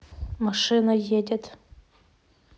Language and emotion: Russian, neutral